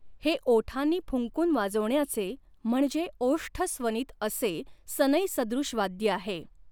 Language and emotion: Marathi, neutral